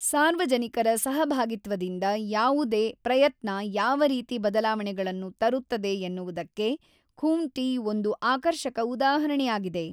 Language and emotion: Kannada, neutral